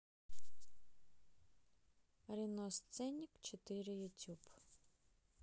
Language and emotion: Russian, neutral